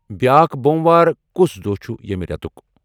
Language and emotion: Kashmiri, neutral